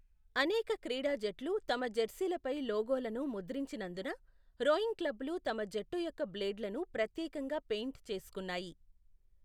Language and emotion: Telugu, neutral